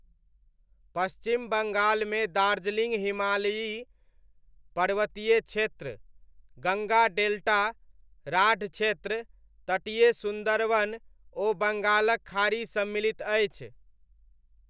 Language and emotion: Maithili, neutral